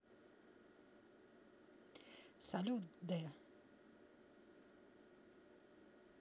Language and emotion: Russian, positive